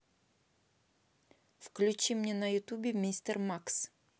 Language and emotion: Russian, neutral